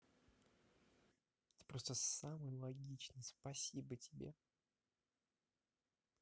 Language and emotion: Russian, neutral